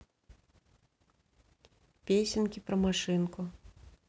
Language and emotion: Russian, neutral